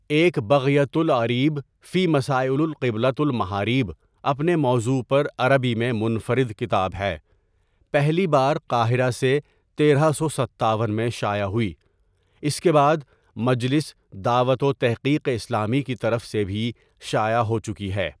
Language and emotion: Urdu, neutral